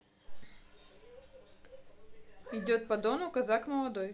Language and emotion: Russian, neutral